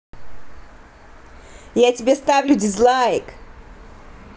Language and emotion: Russian, angry